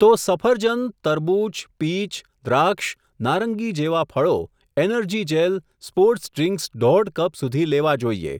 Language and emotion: Gujarati, neutral